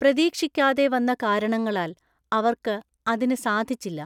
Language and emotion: Malayalam, neutral